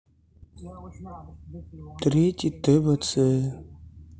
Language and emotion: Russian, sad